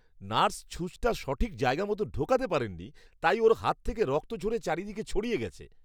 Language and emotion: Bengali, disgusted